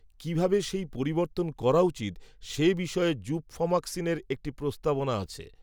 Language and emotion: Bengali, neutral